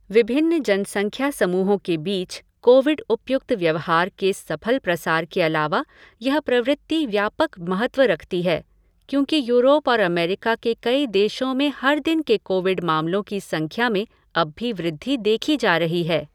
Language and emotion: Hindi, neutral